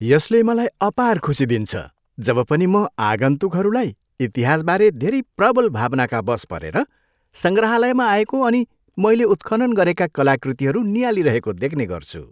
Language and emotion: Nepali, happy